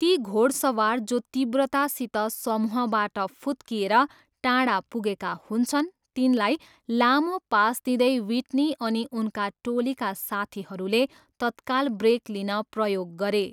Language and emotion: Nepali, neutral